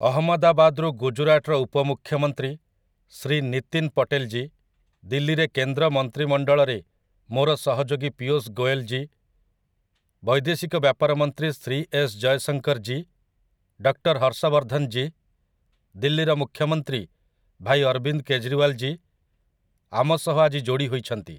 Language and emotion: Odia, neutral